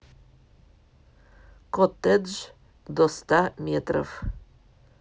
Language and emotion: Russian, neutral